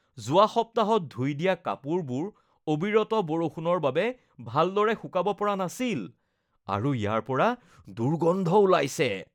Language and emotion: Assamese, disgusted